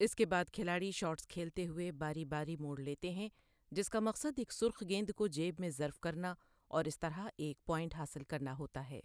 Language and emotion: Urdu, neutral